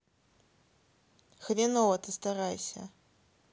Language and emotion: Russian, angry